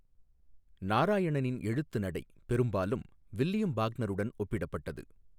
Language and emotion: Tamil, neutral